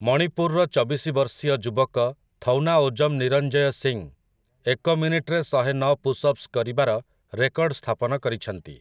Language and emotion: Odia, neutral